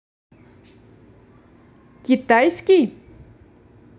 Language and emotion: Russian, neutral